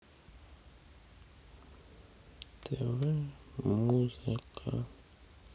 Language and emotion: Russian, sad